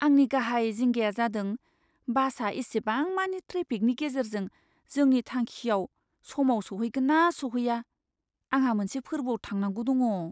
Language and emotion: Bodo, fearful